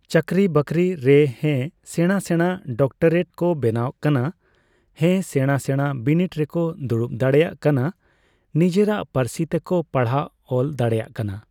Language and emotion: Santali, neutral